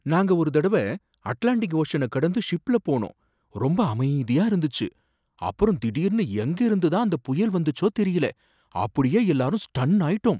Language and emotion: Tamil, surprised